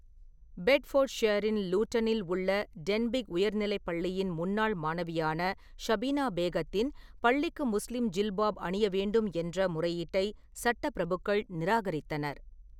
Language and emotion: Tamil, neutral